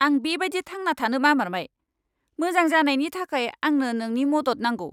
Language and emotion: Bodo, angry